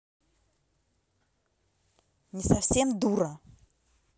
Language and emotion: Russian, angry